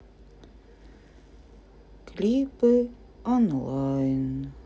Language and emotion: Russian, sad